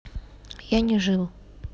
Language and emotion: Russian, neutral